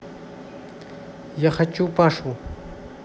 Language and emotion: Russian, neutral